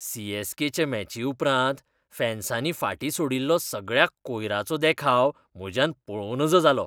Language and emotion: Goan Konkani, disgusted